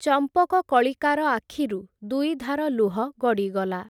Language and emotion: Odia, neutral